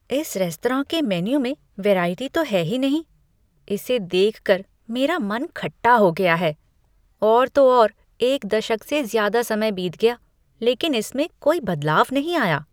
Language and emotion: Hindi, disgusted